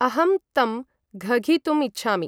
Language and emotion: Sanskrit, neutral